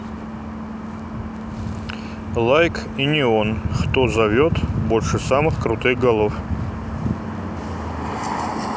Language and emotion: Russian, neutral